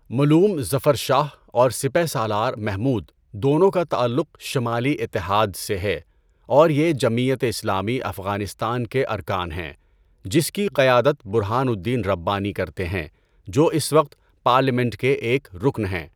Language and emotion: Urdu, neutral